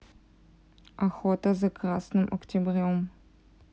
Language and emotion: Russian, neutral